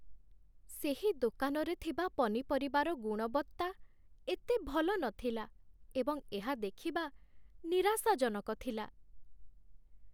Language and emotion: Odia, sad